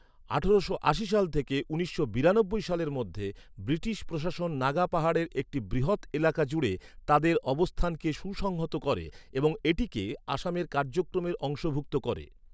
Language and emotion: Bengali, neutral